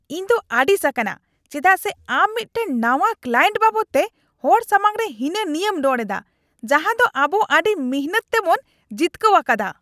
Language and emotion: Santali, angry